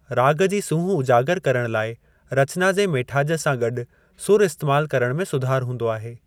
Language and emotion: Sindhi, neutral